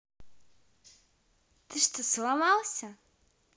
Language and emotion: Russian, angry